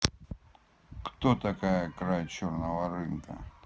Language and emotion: Russian, angry